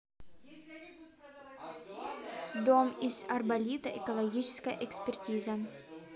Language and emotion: Russian, neutral